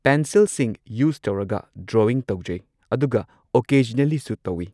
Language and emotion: Manipuri, neutral